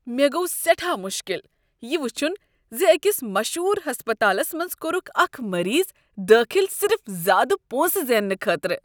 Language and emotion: Kashmiri, disgusted